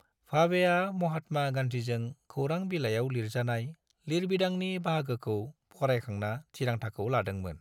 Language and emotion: Bodo, neutral